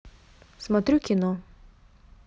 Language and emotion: Russian, neutral